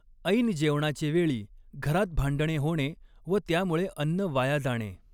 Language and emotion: Marathi, neutral